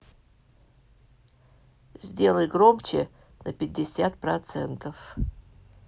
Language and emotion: Russian, neutral